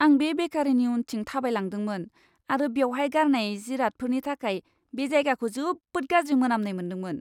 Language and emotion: Bodo, disgusted